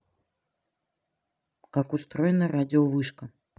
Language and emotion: Russian, neutral